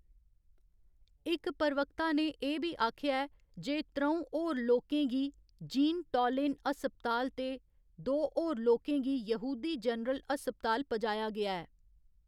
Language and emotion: Dogri, neutral